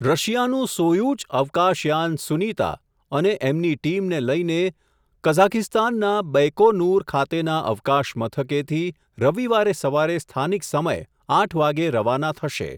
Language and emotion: Gujarati, neutral